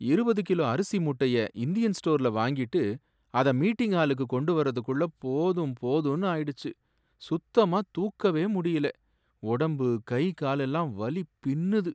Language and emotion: Tamil, sad